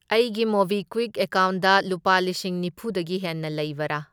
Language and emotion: Manipuri, neutral